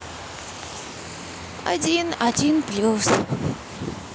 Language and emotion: Russian, neutral